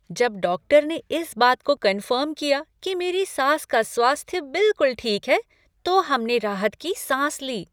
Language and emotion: Hindi, happy